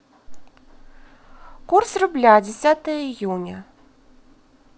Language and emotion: Russian, positive